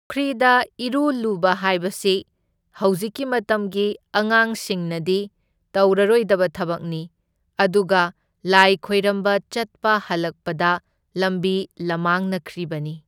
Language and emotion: Manipuri, neutral